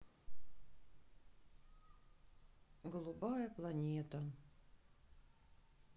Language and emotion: Russian, sad